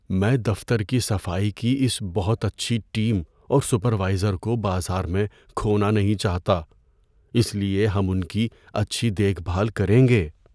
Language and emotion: Urdu, fearful